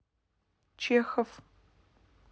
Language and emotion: Russian, neutral